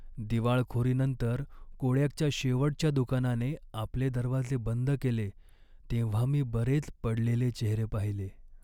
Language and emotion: Marathi, sad